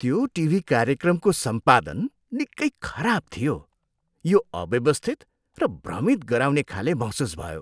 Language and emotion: Nepali, disgusted